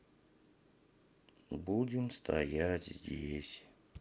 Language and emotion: Russian, sad